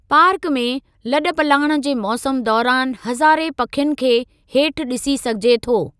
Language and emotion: Sindhi, neutral